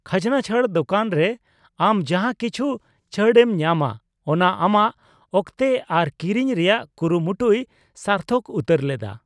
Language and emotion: Santali, neutral